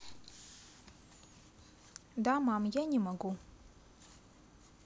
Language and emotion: Russian, neutral